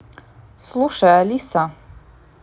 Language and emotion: Russian, neutral